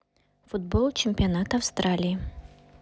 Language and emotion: Russian, neutral